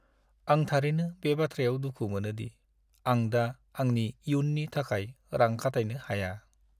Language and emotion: Bodo, sad